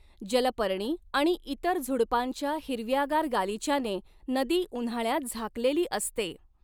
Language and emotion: Marathi, neutral